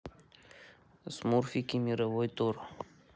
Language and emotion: Russian, neutral